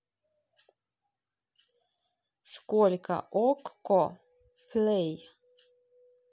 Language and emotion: Russian, neutral